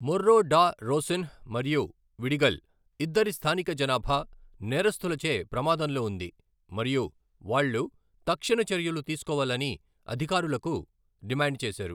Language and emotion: Telugu, neutral